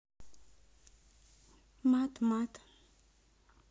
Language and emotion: Russian, neutral